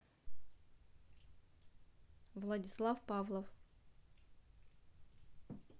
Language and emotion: Russian, neutral